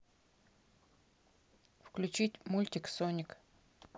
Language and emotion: Russian, neutral